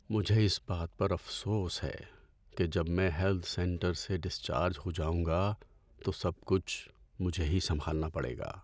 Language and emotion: Urdu, sad